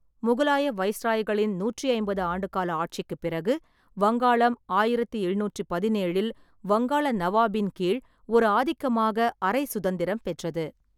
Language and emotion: Tamil, neutral